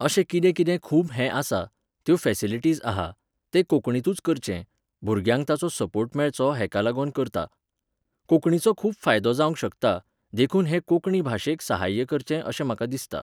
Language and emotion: Goan Konkani, neutral